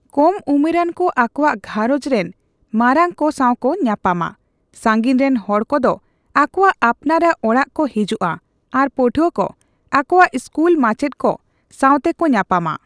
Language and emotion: Santali, neutral